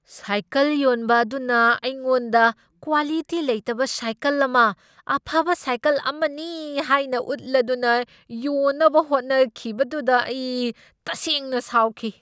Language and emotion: Manipuri, angry